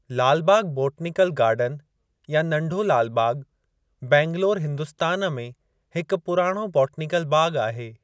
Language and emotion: Sindhi, neutral